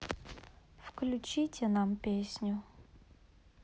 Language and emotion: Russian, sad